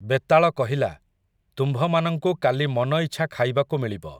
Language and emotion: Odia, neutral